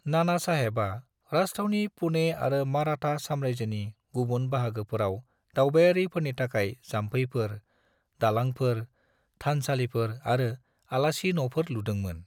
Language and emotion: Bodo, neutral